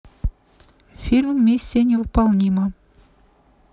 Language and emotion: Russian, neutral